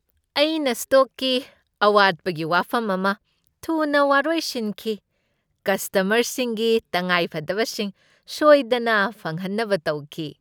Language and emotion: Manipuri, happy